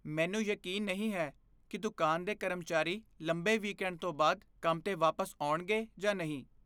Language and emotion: Punjabi, fearful